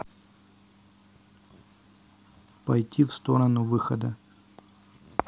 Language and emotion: Russian, neutral